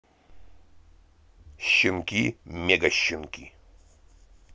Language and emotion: Russian, positive